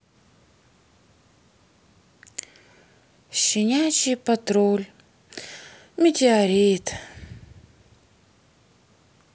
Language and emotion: Russian, sad